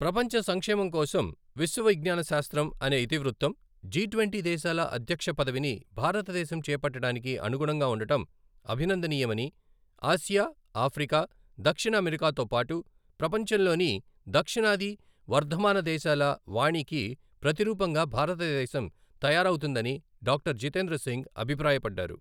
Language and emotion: Telugu, neutral